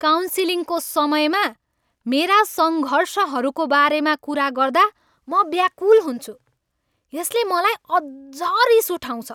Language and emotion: Nepali, angry